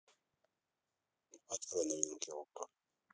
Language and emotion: Russian, neutral